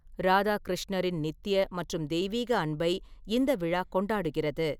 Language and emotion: Tamil, neutral